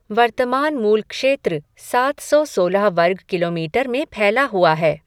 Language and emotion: Hindi, neutral